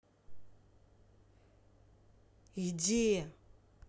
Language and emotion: Russian, angry